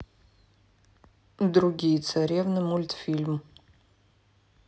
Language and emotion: Russian, neutral